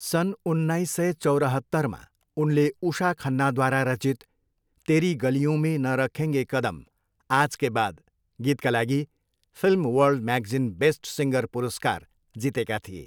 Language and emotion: Nepali, neutral